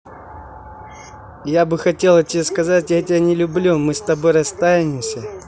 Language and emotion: Russian, angry